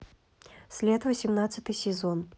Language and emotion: Russian, neutral